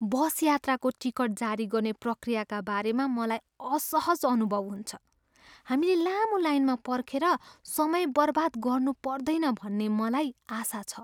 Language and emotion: Nepali, fearful